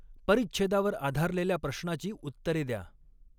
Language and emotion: Marathi, neutral